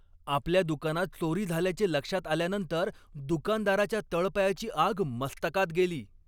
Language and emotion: Marathi, angry